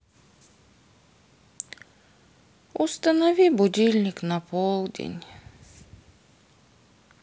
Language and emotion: Russian, sad